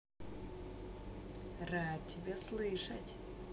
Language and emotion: Russian, positive